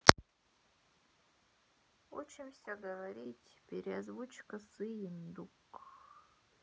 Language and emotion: Russian, sad